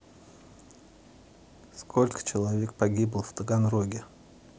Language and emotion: Russian, neutral